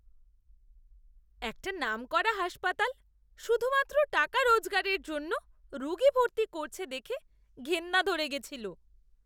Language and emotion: Bengali, disgusted